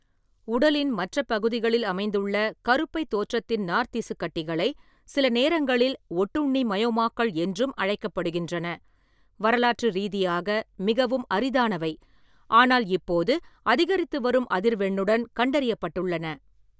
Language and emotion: Tamil, neutral